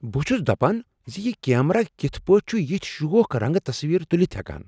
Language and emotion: Kashmiri, surprised